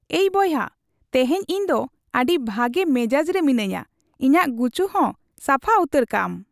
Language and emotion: Santali, happy